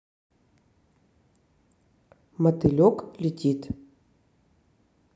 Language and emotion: Russian, neutral